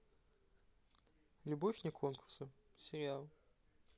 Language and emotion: Russian, neutral